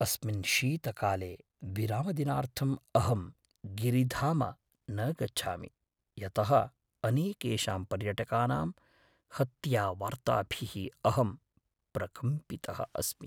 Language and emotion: Sanskrit, fearful